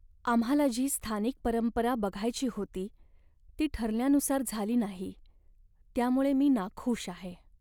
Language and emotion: Marathi, sad